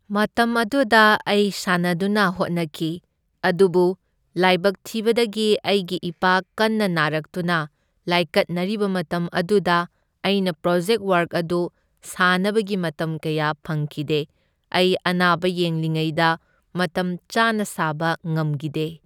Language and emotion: Manipuri, neutral